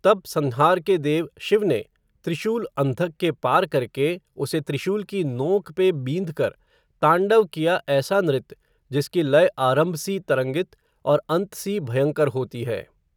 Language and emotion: Hindi, neutral